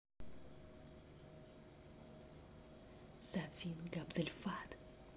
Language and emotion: Russian, neutral